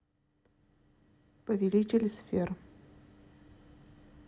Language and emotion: Russian, neutral